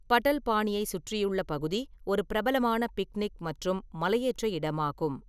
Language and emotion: Tamil, neutral